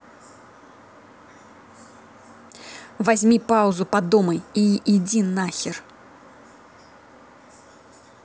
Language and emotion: Russian, angry